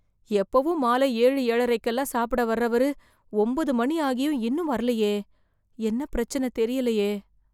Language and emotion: Tamil, fearful